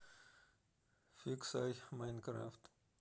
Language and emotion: Russian, neutral